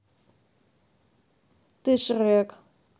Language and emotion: Russian, neutral